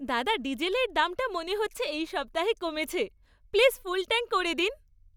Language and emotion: Bengali, happy